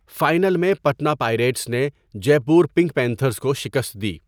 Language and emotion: Urdu, neutral